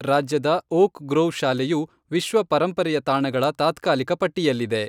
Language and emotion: Kannada, neutral